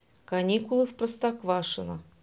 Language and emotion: Russian, neutral